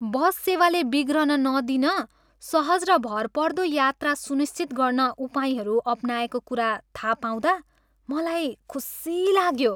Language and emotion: Nepali, happy